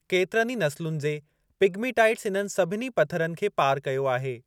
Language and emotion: Sindhi, neutral